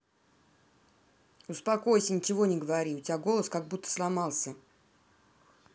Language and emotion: Russian, angry